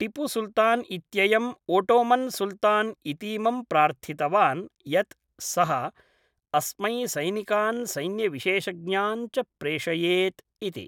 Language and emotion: Sanskrit, neutral